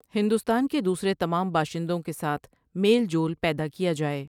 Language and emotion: Urdu, neutral